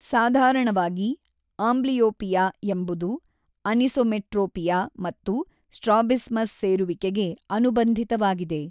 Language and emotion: Kannada, neutral